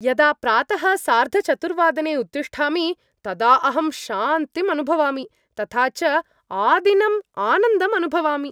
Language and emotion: Sanskrit, happy